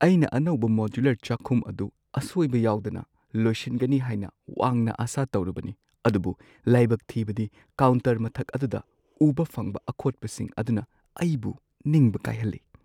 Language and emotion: Manipuri, sad